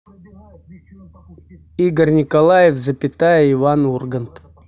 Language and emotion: Russian, neutral